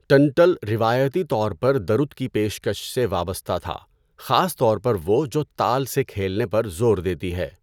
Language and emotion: Urdu, neutral